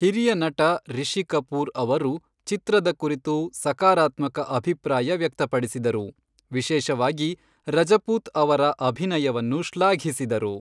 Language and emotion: Kannada, neutral